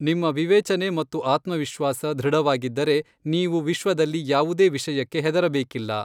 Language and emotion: Kannada, neutral